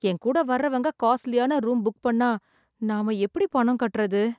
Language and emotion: Tamil, sad